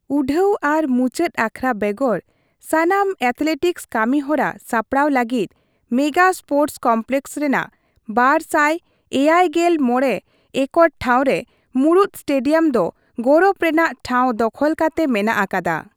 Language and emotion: Santali, neutral